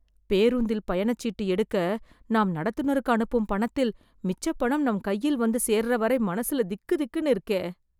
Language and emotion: Tamil, fearful